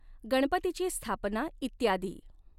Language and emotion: Marathi, neutral